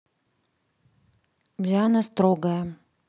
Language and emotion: Russian, neutral